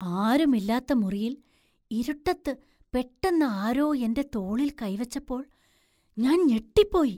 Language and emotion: Malayalam, surprised